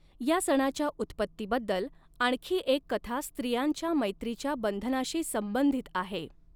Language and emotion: Marathi, neutral